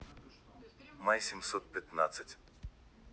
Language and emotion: Russian, neutral